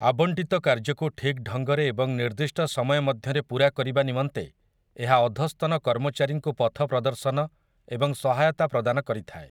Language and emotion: Odia, neutral